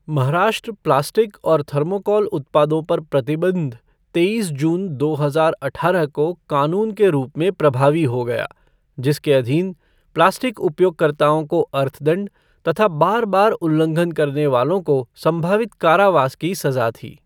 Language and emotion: Hindi, neutral